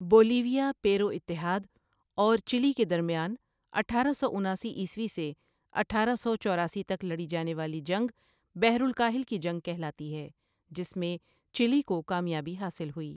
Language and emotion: Urdu, neutral